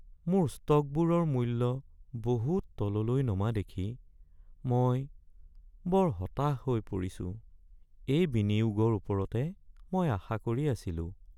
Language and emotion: Assamese, sad